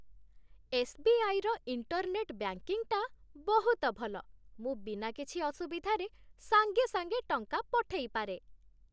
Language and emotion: Odia, happy